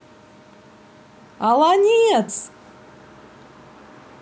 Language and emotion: Russian, positive